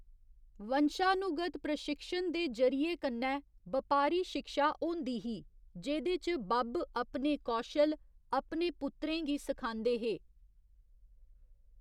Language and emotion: Dogri, neutral